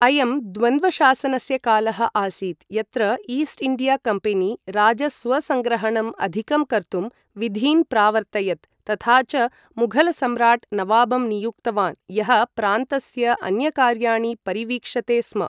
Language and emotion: Sanskrit, neutral